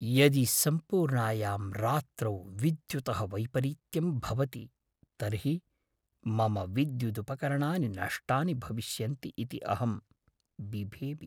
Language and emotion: Sanskrit, fearful